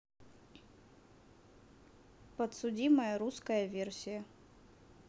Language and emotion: Russian, neutral